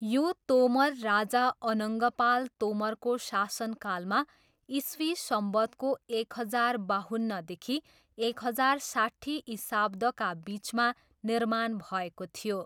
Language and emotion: Nepali, neutral